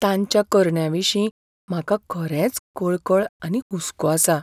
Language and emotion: Goan Konkani, fearful